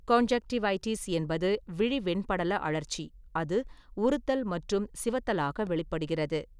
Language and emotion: Tamil, neutral